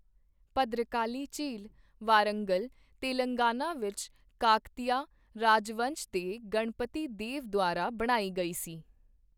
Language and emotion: Punjabi, neutral